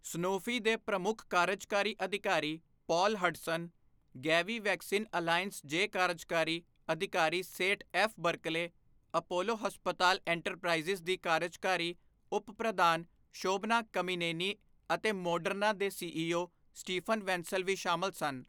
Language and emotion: Punjabi, neutral